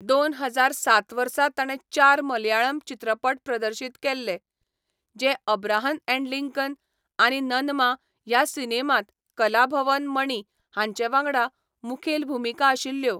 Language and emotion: Goan Konkani, neutral